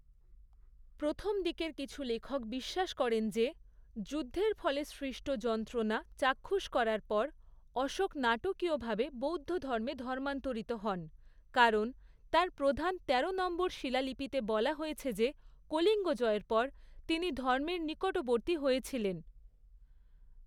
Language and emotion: Bengali, neutral